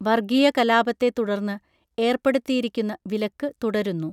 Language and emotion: Malayalam, neutral